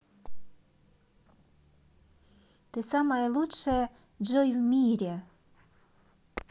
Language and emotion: Russian, positive